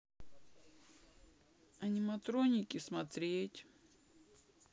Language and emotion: Russian, sad